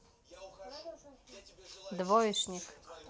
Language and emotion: Russian, neutral